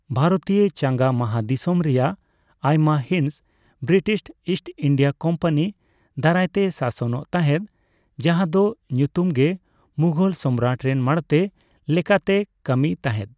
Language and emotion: Santali, neutral